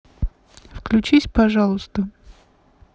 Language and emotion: Russian, neutral